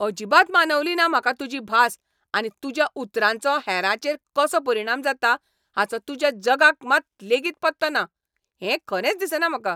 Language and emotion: Goan Konkani, angry